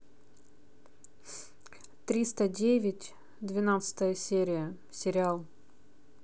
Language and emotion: Russian, neutral